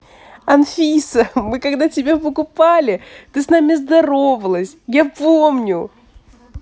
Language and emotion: Russian, positive